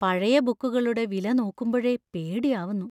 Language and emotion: Malayalam, fearful